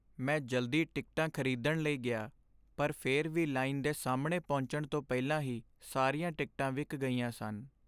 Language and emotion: Punjabi, sad